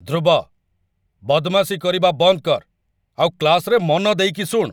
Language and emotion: Odia, angry